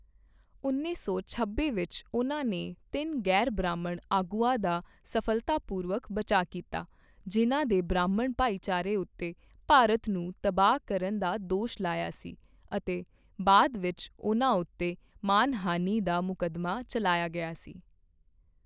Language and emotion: Punjabi, neutral